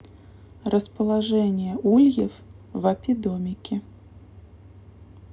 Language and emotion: Russian, neutral